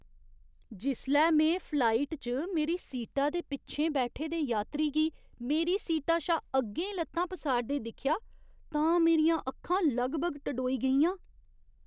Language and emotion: Dogri, surprised